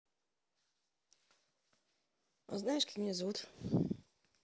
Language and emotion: Russian, neutral